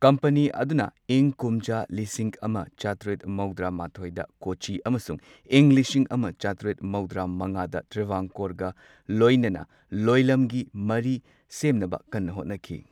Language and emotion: Manipuri, neutral